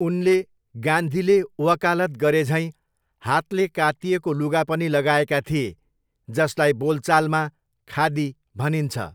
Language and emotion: Nepali, neutral